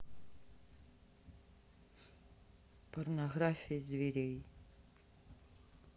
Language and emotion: Russian, neutral